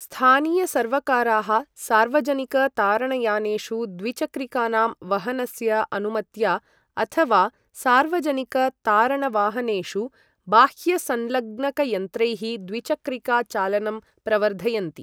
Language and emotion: Sanskrit, neutral